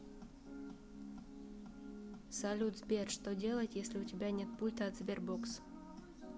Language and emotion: Russian, neutral